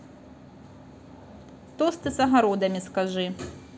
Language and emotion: Russian, neutral